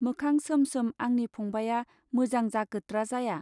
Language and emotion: Bodo, neutral